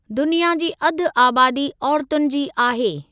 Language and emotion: Sindhi, neutral